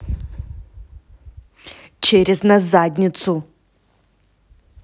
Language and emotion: Russian, angry